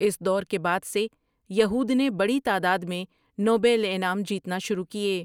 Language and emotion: Urdu, neutral